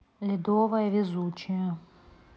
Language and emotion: Russian, neutral